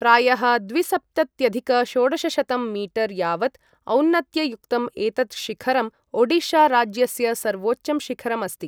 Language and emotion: Sanskrit, neutral